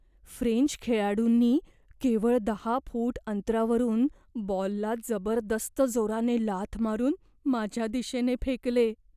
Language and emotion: Marathi, fearful